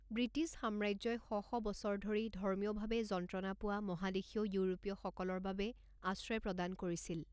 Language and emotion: Assamese, neutral